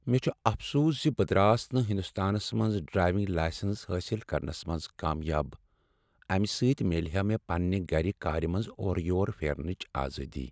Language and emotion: Kashmiri, sad